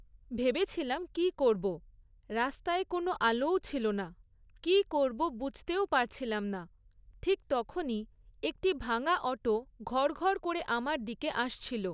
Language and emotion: Bengali, neutral